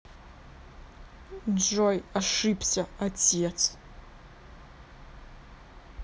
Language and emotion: Russian, angry